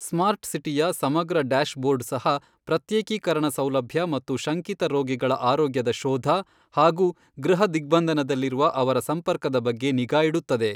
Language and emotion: Kannada, neutral